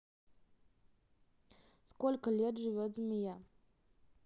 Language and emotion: Russian, neutral